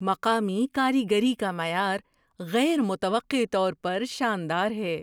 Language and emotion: Urdu, surprised